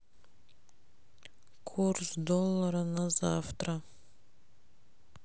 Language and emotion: Russian, sad